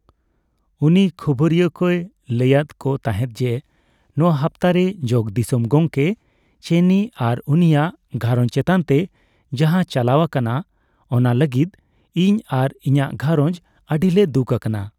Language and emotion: Santali, neutral